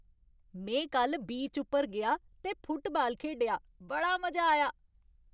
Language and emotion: Dogri, happy